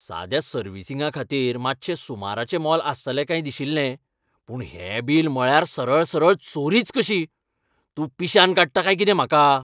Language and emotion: Goan Konkani, angry